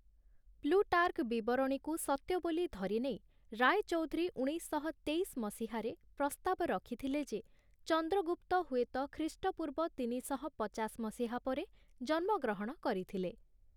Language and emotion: Odia, neutral